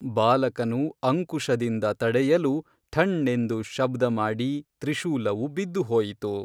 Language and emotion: Kannada, neutral